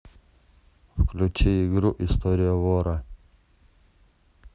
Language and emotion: Russian, neutral